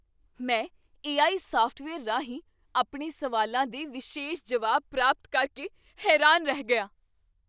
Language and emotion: Punjabi, surprised